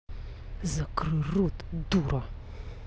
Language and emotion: Russian, angry